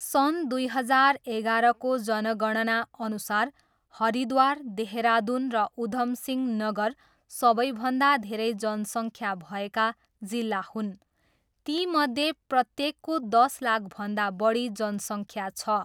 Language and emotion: Nepali, neutral